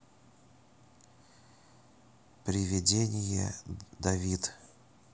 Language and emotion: Russian, neutral